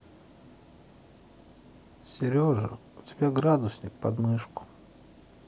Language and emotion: Russian, sad